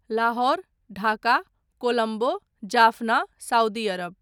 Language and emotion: Maithili, neutral